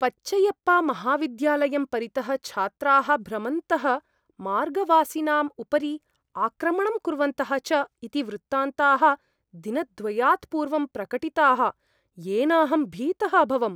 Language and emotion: Sanskrit, fearful